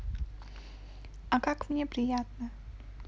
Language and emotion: Russian, positive